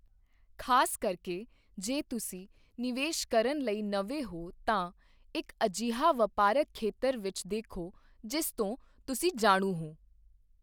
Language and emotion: Punjabi, neutral